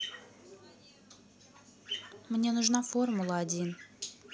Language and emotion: Russian, neutral